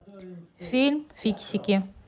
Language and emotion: Russian, neutral